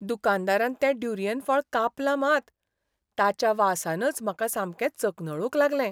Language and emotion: Goan Konkani, disgusted